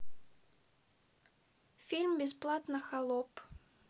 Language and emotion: Russian, neutral